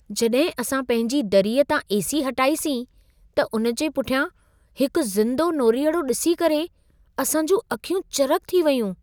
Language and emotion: Sindhi, surprised